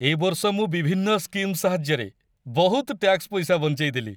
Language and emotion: Odia, happy